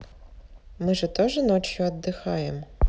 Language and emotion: Russian, neutral